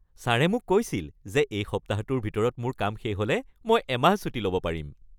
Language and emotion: Assamese, happy